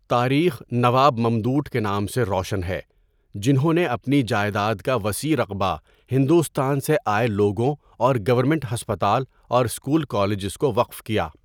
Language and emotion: Urdu, neutral